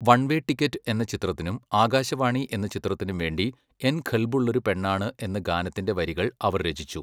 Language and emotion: Malayalam, neutral